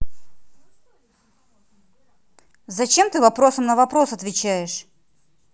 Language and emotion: Russian, angry